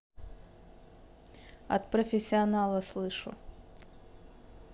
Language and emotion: Russian, neutral